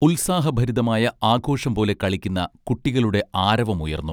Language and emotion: Malayalam, neutral